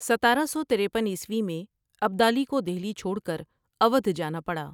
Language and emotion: Urdu, neutral